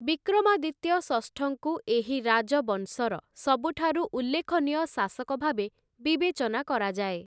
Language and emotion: Odia, neutral